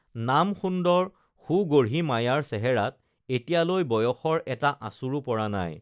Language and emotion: Assamese, neutral